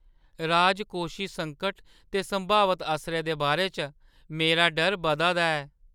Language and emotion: Dogri, fearful